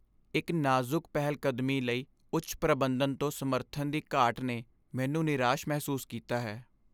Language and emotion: Punjabi, sad